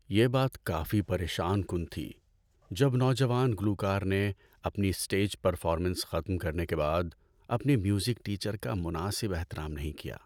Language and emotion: Urdu, sad